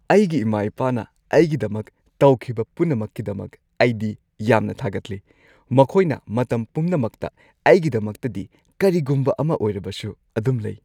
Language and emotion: Manipuri, happy